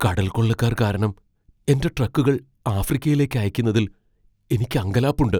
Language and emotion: Malayalam, fearful